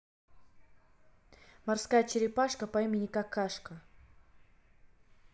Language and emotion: Russian, neutral